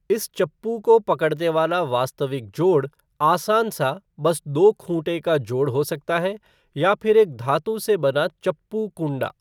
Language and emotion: Hindi, neutral